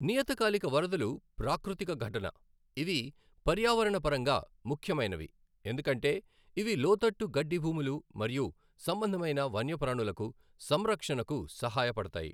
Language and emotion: Telugu, neutral